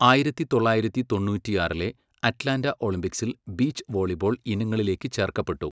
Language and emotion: Malayalam, neutral